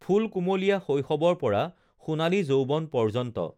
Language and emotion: Assamese, neutral